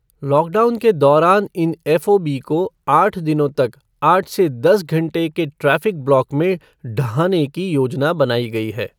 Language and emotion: Hindi, neutral